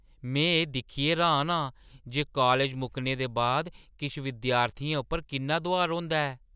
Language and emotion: Dogri, surprised